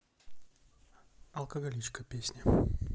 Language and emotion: Russian, neutral